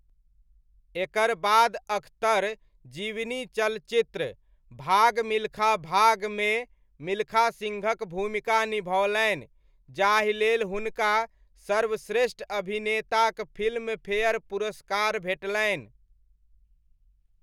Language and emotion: Maithili, neutral